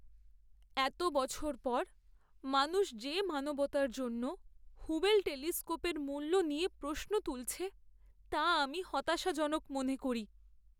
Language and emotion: Bengali, sad